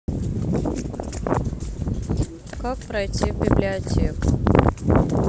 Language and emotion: Russian, neutral